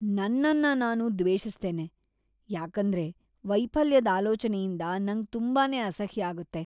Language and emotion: Kannada, disgusted